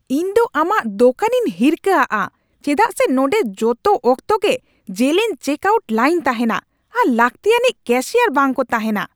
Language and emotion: Santali, angry